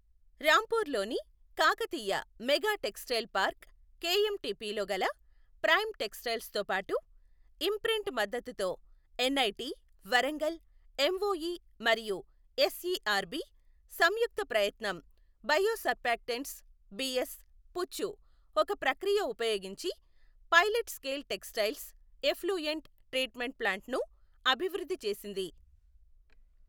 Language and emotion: Telugu, neutral